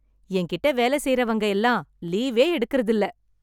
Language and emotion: Tamil, happy